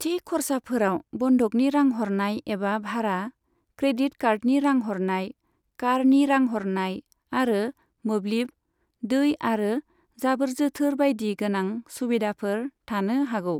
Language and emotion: Bodo, neutral